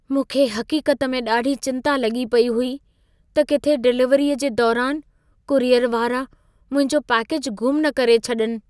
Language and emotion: Sindhi, fearful